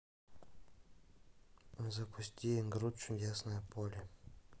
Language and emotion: Russian, neutral